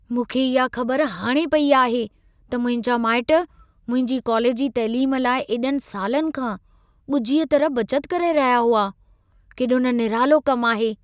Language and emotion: Sindhi, surprised